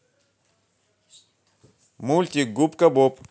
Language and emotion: Russian, positive